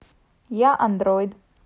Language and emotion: Russian, neutral